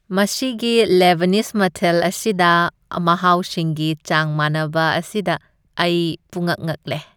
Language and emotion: Manipuri, happy